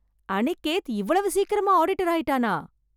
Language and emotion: Tamil, surprised